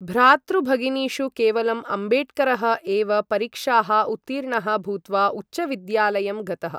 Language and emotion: Sanskrit, neutral